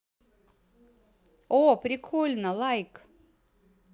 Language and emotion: Russian, positive